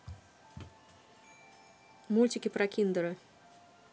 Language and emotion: Russian, neutral